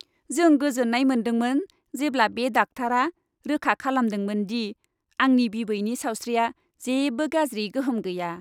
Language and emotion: Bodo, happy